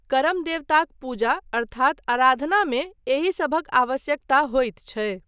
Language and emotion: Maithili, neutral